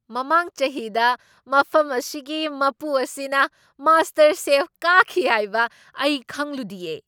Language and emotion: Manipuri, surprised